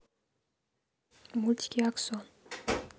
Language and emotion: Russian, neutral